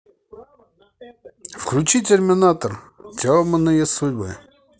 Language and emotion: Russian, positive